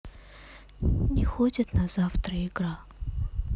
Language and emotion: Russian, sad